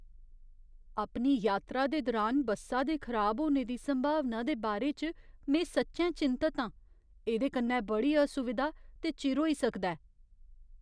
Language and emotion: Dogri, fearful